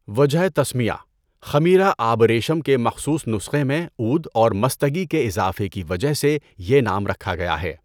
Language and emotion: Urdu, neutral